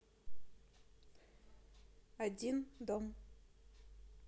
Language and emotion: Russian, neutral